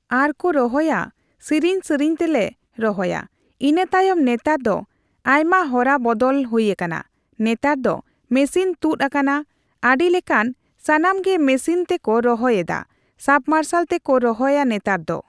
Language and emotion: Santali, neutral